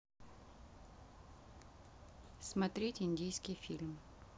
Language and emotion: Russian, neutral